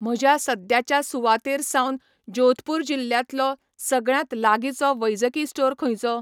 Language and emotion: Goan Konkani, neutral